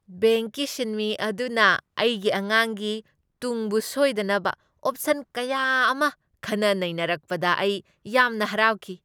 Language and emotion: Manipuri, happy